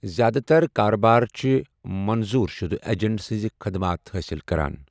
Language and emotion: Kashmiri, neutral